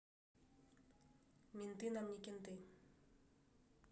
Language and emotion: Russian, neutral